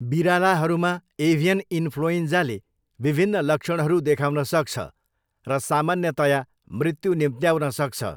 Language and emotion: Nepali, neutral